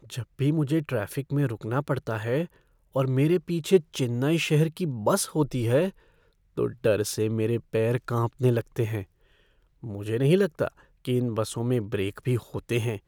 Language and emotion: Hindi, fearful